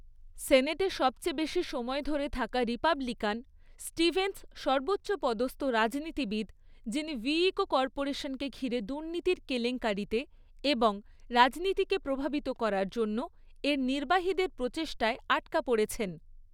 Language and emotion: Bengali, neutral